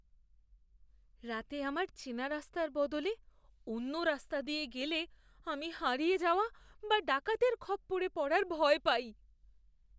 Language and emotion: Bengali, fearful